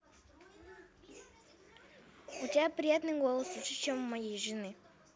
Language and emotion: Russian, positive